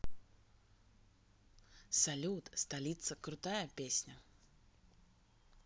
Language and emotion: Russian, positive